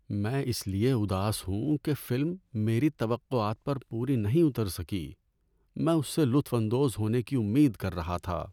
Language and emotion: Urdu, sad